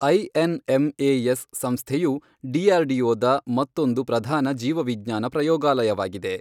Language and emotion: Kannada, neutral